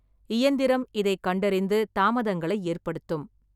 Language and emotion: Tamil, neutral